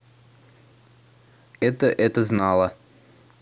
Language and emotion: Russian, neutral